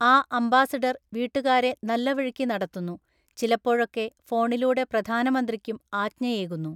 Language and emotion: Malayalam, neutral